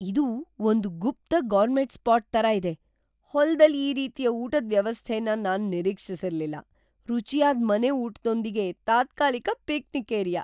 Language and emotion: Kannada, surprised